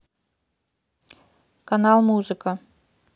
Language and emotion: Russian, neutral